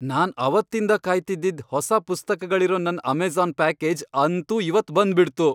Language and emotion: Kannada, happy